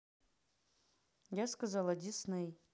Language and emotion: Russian, angry